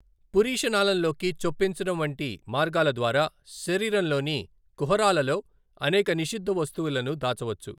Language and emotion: Telugu, neutral